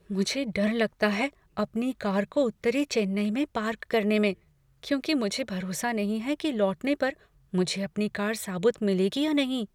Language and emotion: Hindi, fearful